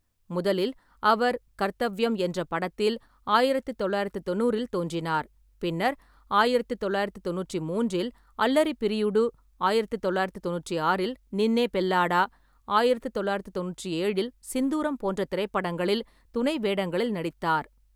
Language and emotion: Tamil, neutral